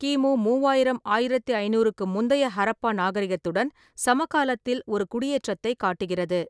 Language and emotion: Tamil, neutral